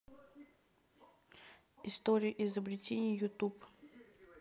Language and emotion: Russian, neutral